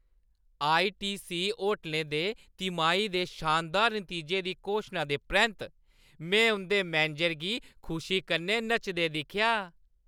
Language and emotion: Dogri, happy